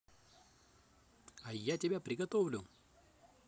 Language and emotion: Russian, positive